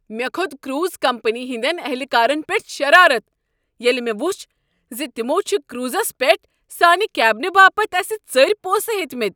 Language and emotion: Kashmiri, angry